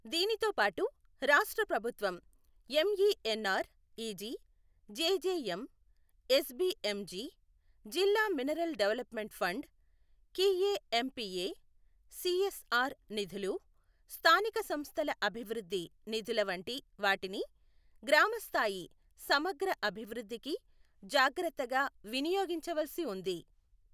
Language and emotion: Telugu, neutral